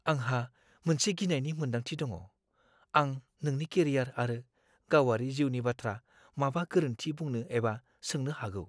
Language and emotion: Bodo, fearful